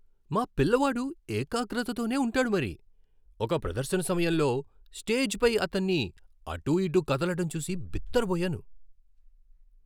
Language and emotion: Telugu, surprised